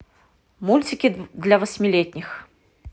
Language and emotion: Russian, neutral